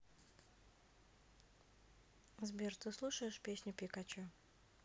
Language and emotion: Russian, neutral